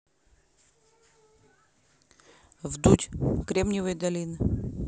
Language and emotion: Russian, neutral